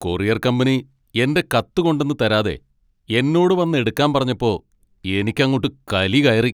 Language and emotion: Malayalam, angry